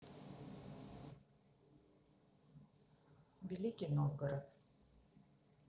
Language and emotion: Russian, neutral